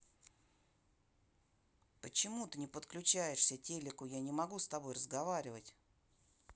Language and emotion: Russian, angry